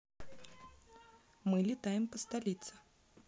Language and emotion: Russian, positive